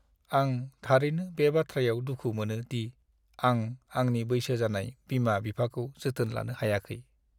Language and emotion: Bodo, sad